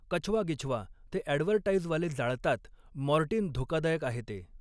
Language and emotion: Marathi, neutral